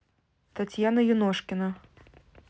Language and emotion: Russian, neutral